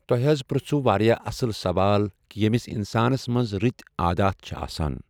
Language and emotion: Kashmiri, neutral